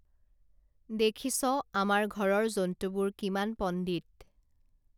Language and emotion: Assamese, neutral